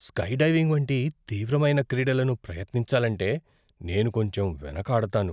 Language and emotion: Telugu, fearful